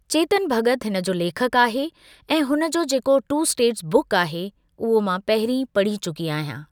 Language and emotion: Sindhi, neutral